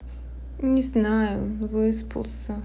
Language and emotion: Russian, sad